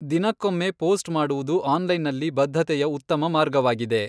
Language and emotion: Kannada, neutral